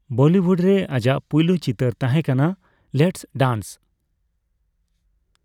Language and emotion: Santali, neutral